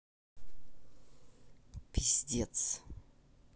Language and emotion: Russian, angry